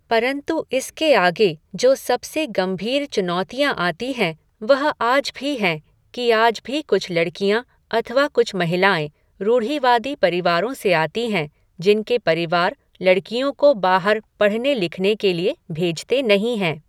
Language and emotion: Hindi, neutral